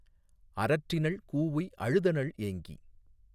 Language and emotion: Tamil, neutral